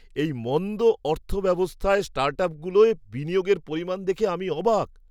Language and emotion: Bengali, surprised